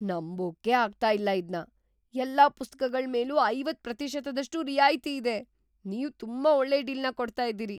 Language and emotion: Kannada, surprised